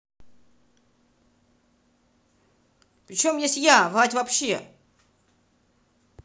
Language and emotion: Russian, angry